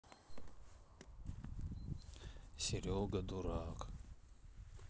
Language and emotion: Russian, sad